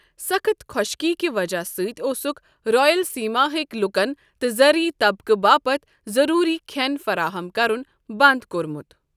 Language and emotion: Kashmiri, neutral